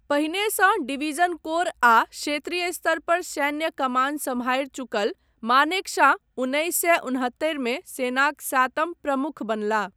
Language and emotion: Maithili, neutral